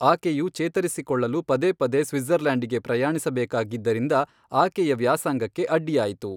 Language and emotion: Kannada, neutral